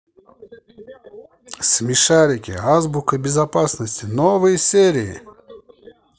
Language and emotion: Russian, positive